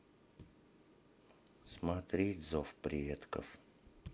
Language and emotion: Russian, sad